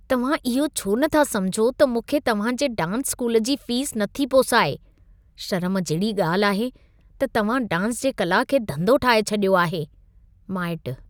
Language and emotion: Sindhi, disgusted